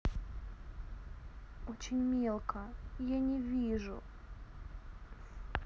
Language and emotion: Russian, sad